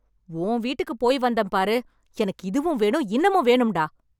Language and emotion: Tamil, angry